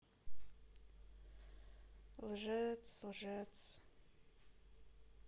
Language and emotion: Russian, sad